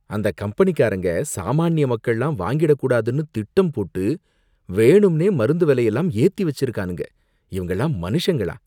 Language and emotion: Tamil, disgusted